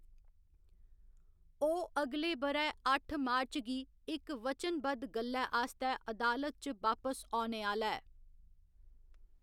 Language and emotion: Dogri, neutral